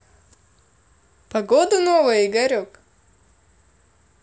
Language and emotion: Russian, positive